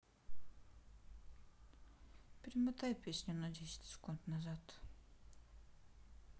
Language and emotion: Russian, sad